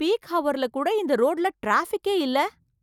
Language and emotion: Tamil, surprised